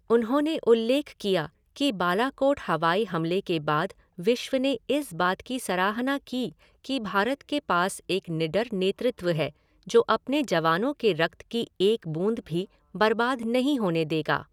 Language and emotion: Hindi, neutral